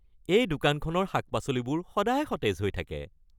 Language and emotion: Assamese, happy